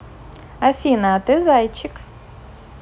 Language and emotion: Russian, positive